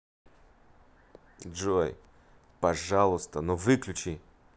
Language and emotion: Russian, angry